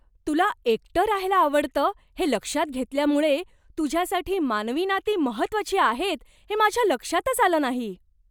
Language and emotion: Marathi, surprised